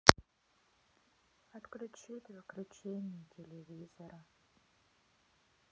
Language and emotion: Russian, sad